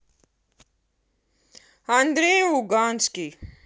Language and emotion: Russian, angry